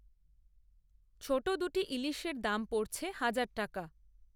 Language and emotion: Bengali, neutral